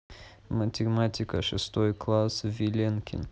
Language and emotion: Russian, neutral